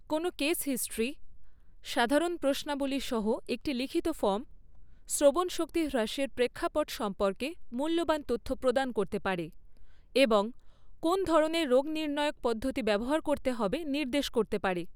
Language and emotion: Bengali, neutral